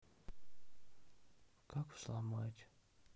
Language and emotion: Russian, sad